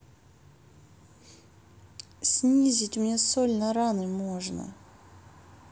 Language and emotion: Russian, sad